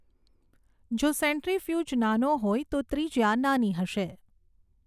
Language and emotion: Gujarati, neutral